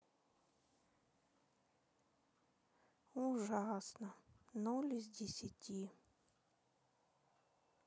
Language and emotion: Russian, sad